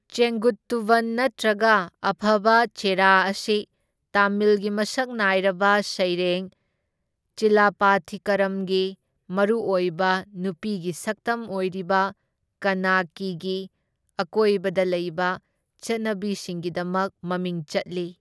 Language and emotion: Manipuri, neutral